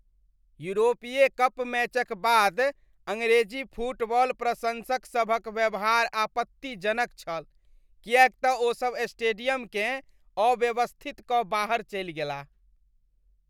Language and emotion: Maithili, disgusted